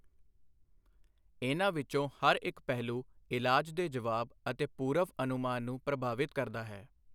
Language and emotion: Punjabi, neutral